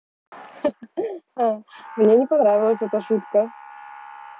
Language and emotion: Russian, positive